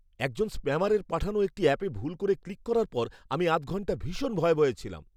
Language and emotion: Bengali, fearful